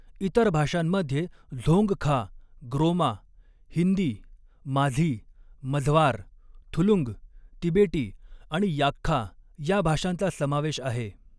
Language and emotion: Marathi, neutral